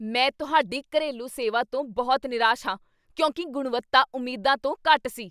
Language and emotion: Punjabi, angry